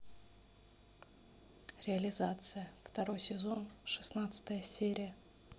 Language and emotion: Russian, neutral